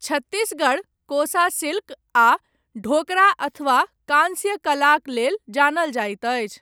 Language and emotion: Maithili, neutral